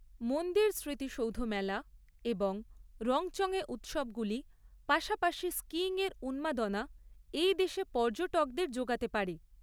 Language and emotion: Bengali, neutral